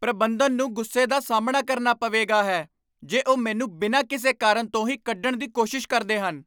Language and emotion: Punjabi, angry